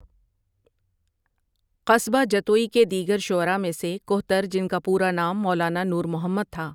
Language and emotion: Urdu, neutral